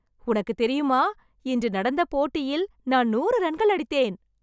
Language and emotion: Tamil, happy